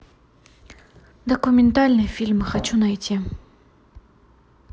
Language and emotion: Russian, neutral